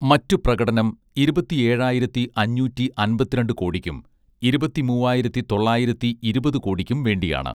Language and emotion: Malayalam, neutral